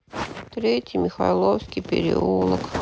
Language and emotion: Russian, sad